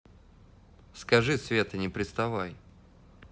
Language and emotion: Russian, neutral